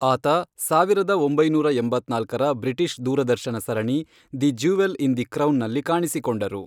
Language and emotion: Kannada, neutral